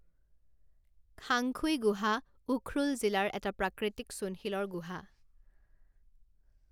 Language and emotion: Assamese, neutral